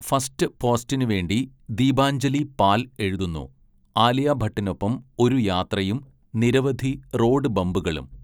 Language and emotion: Malayalam, neutral